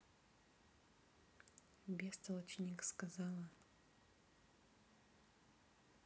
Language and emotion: Russian, neutral